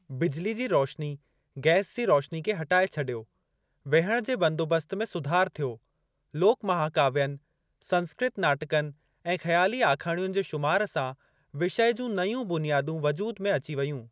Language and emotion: Sindhi, neutral